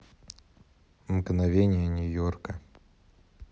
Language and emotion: Russian, neutral